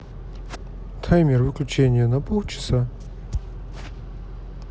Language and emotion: Russian, neutral